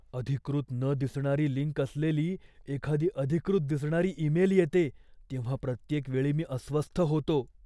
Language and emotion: Marathi, fearful